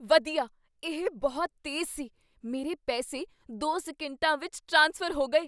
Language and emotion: Punjabi, surprised